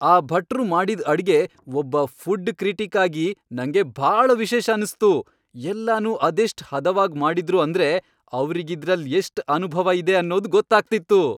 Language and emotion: Kannada, happy